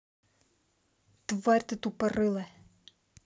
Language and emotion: Russian, angry